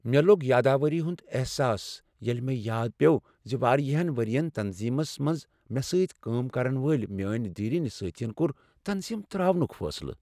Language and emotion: Kashmiri, sad